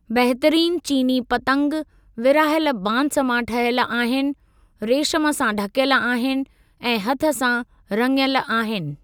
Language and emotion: Sindhi, neutral